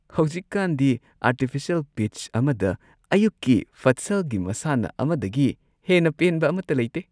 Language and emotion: Manipuri, happy